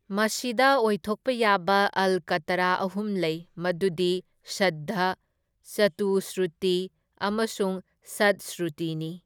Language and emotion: Manipuri, neutral